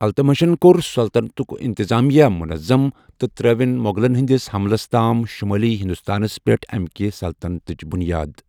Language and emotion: Kashmiri, neutral